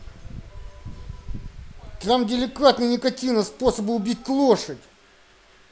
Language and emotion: Russian, angry